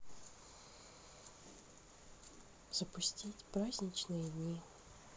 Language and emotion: Russian, sad